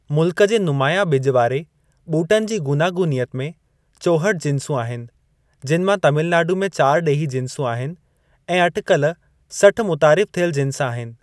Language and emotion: Sindhi, neutral